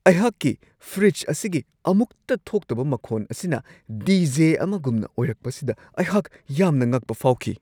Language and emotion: Manipuri, surprised